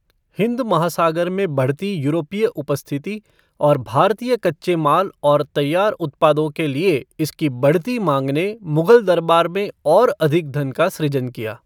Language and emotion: Hindi, neutral